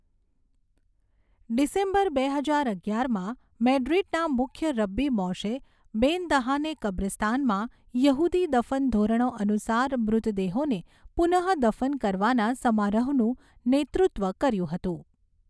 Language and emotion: Gujarati, neutral